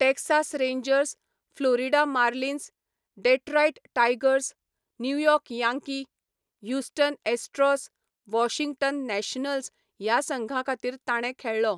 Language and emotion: Goan Konkani, neutral